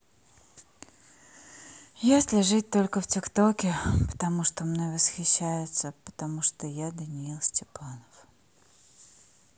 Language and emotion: Russian, sad